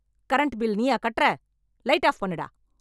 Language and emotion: Tamil, angry